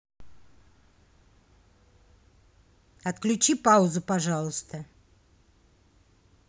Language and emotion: Russian, neutral